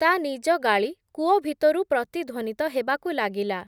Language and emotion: Odia, neutral